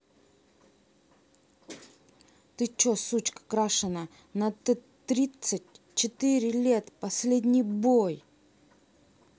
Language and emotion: Russian, angry